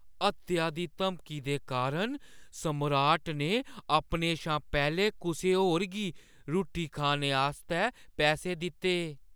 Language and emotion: Dogri, fearful